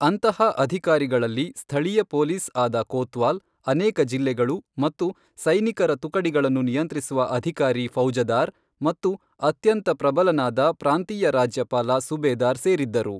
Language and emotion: Kannada, neutral